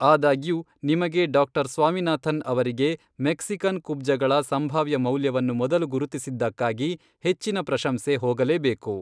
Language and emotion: Kannada, neutral